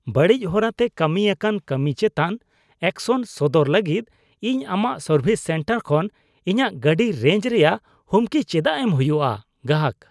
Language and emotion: Santali, disgusted